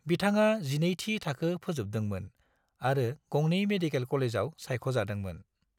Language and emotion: Bodo, neutral